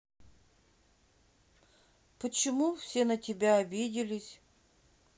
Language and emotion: Russian, sad